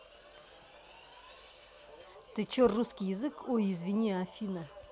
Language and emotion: Russian, angry